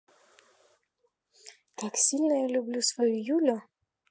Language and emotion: Russian, positive